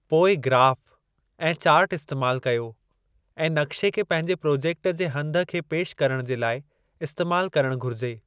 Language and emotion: Sindhi, neutral